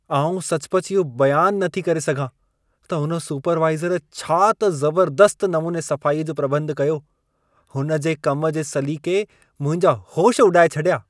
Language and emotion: Sindhi, surprised